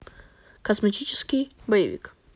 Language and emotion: Russian, neutral